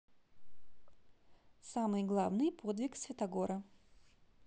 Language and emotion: Russian, neutral